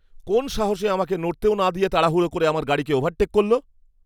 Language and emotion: Bengali, angry